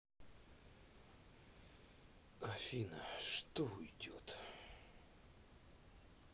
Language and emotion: Russian, sad